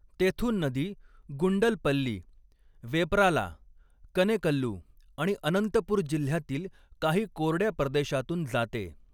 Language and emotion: Marathi, neutral